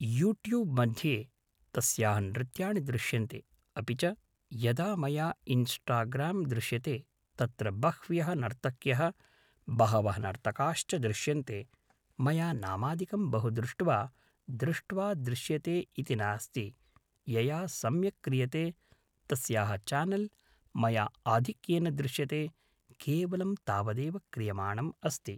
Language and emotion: Sanskrit, neutral